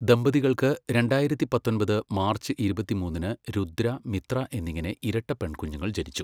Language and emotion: Malayalam, neutral